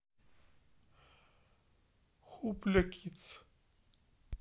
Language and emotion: Russian, neutral